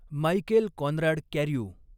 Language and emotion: Marathi, neutral